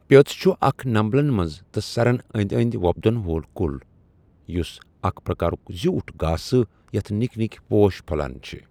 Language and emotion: Kashmiri, neutral